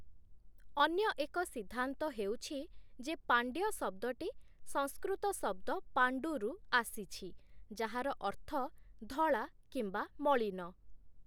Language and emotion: Odia, neutral